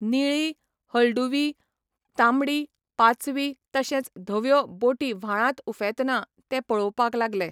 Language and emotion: Goan Konkani, neutral